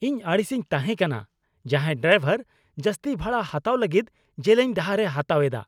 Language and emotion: Santali, angry